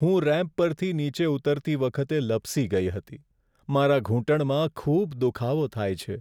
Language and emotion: Gujarati, sad